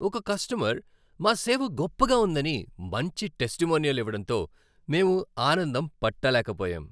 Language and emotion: Telugu, happy